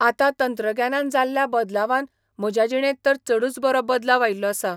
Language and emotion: Goan Konkani, neutral